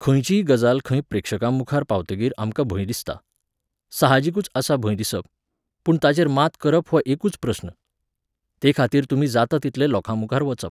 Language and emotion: Goan Konkani, neutral